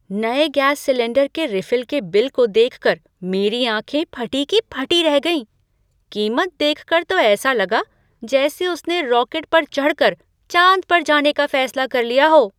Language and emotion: Hindi, surprised